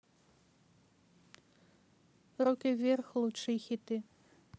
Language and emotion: Russian, neutral